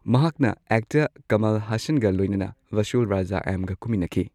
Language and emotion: Manipuri, neutral